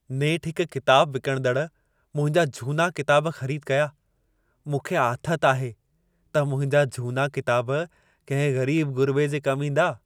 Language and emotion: Sindhi, happy